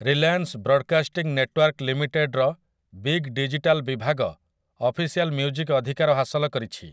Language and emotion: Odia, neutral